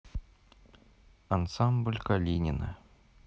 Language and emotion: Russian, neutral